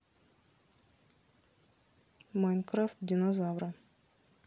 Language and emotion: Russian, neutral